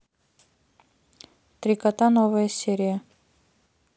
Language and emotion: Russian, neutral